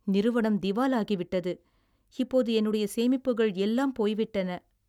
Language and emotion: Tamil, sad